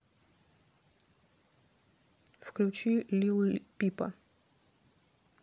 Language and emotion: Russian, neutral